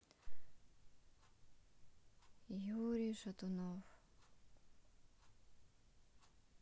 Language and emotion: Russian, sad